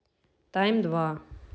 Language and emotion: Russian, neutral